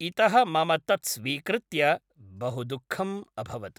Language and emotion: Sanskrit, neutral